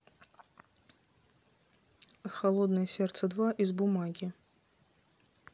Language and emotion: Russian, neutral